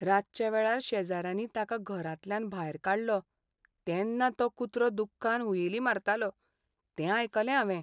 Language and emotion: Goan Konkani, sad